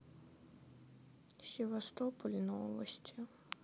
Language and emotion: Russian, sad